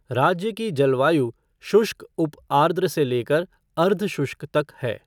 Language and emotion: Hindi, neutral